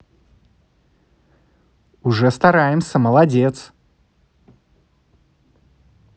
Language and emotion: Russian, positive